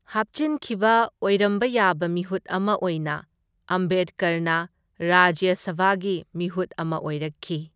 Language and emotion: Manipuri, neutral